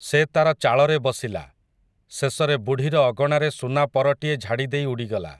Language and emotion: Odia, neutral